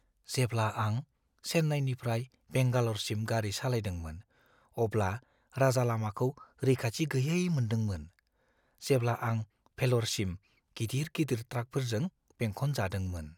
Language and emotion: Bodo, fearful